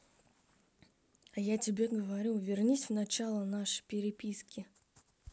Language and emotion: Russian, neutral